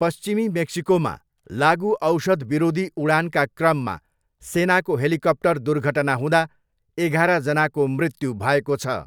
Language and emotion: Nepali, neutral